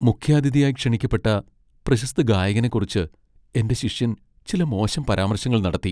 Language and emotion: Malayalam, sad